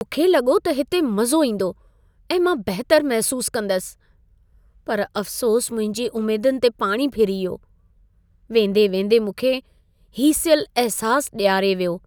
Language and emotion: Sindhi, sad